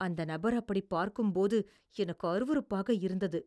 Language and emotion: Tamil, disgusted